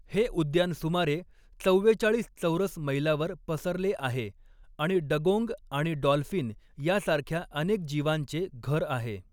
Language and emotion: Marathi, neutral